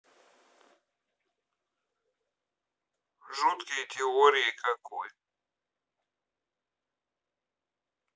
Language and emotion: Russian, neutral